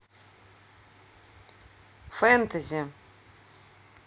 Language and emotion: Russian, neutral